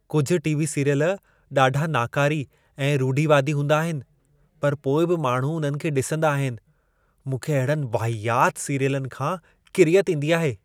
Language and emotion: Sindhi, disgusted